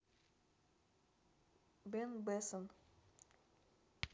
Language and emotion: Russian, neutral